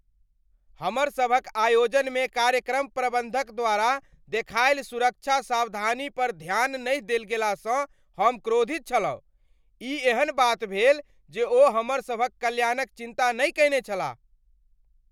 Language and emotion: Maithili, angry